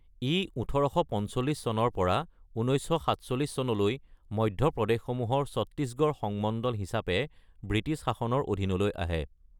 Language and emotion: Assamese, neutral